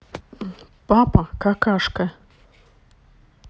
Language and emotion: Russian, neutral